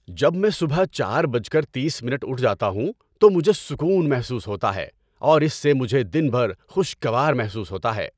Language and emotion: Urdu, happy